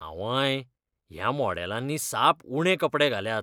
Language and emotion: Goan Konkani, disgusted